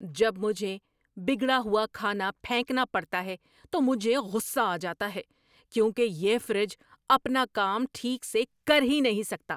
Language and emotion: Urdu, angry